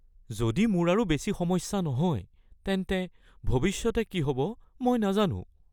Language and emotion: Assamese, fearful